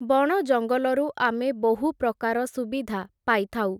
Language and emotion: Odia, neutral